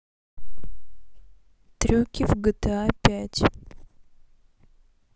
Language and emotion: Russian, neutral